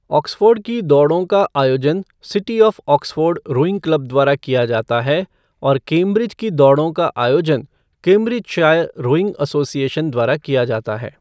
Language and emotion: Hindi, neutral